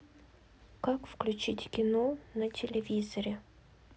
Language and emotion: Russian, sad